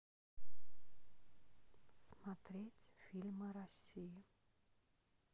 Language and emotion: Russian, neutral